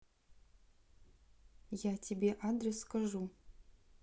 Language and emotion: Russian, neutral